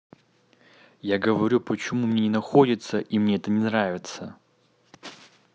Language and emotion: Russian, neutral